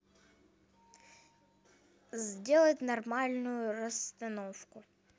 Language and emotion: Russian, neutral